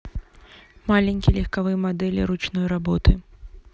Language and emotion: Russian, neutral